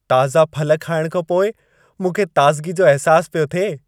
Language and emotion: Sindhi, happy